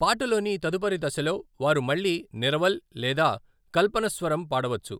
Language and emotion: Telugu, neutral